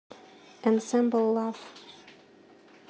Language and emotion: Russian, neutral